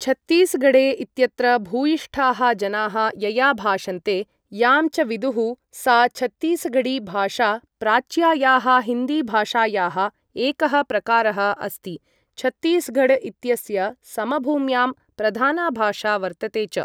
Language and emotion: Sanskrit, neutral